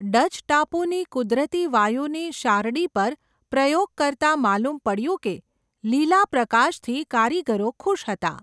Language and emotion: Gujarati, neutral